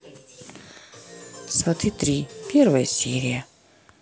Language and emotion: Russian, neutral